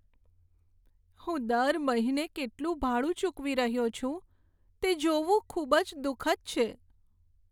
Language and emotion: Gujarati, sad